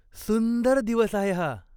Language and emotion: Marathi, happy